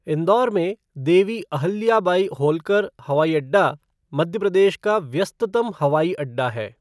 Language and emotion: Hindi, neutral